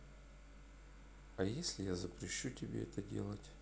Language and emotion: Russian, neutral